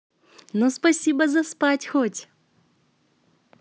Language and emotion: Russian, positive